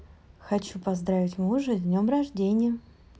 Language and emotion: Russian, positive